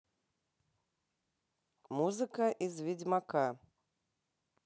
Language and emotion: Russian, neutral